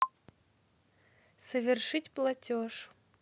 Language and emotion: Russian, neutral